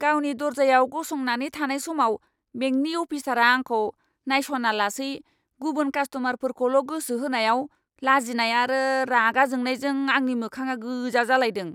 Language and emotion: Bodo, angry